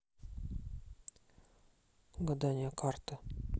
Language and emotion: Russian, neutral